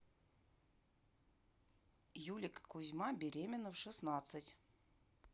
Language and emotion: Russian, neutral